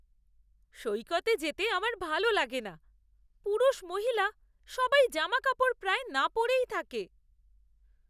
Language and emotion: Bengali, disgusted